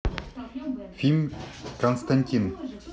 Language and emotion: Russian, neutral